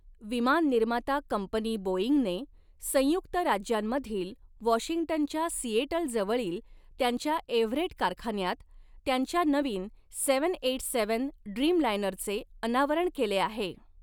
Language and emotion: Marathi, neutral